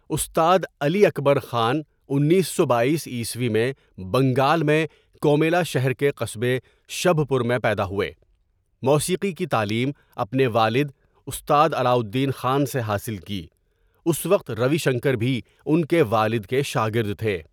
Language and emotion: Urdu, neutral